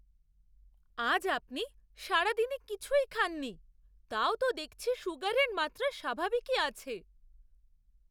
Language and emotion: Bengali, surprised